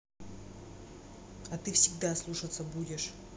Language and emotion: Russian, angry